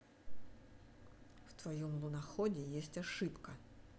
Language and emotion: Russian, neutral